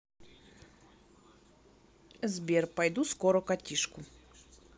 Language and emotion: Russian, neutral